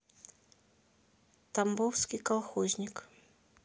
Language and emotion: Russian, neutral